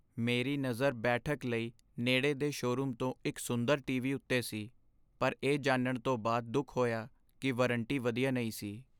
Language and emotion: Punjabi, sad